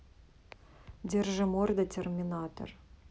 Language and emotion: Russian, neutral